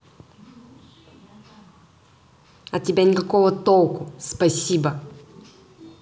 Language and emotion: Russian, angry